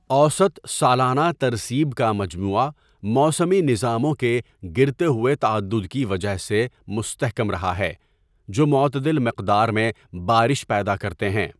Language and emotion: Urdu, neutral